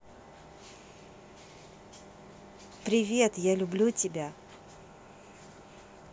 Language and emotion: Russian, positive